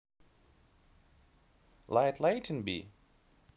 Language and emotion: Russian, neutral